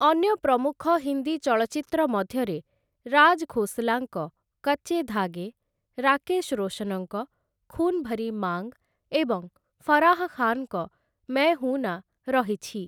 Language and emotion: Odia, neutral